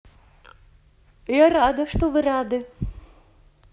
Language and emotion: Russian, positive